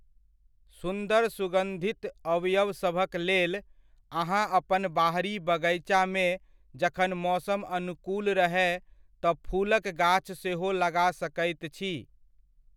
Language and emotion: Maithili, neutral